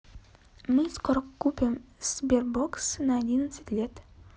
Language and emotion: Russian, neutral